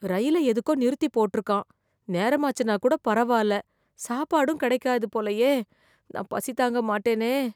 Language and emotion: Tamil, fearful